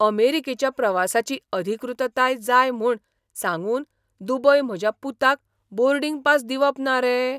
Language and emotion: Goan Konkani, surprised